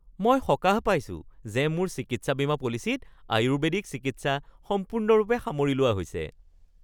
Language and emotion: Assamese, happy